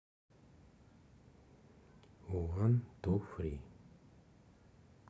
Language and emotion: Russian, neutral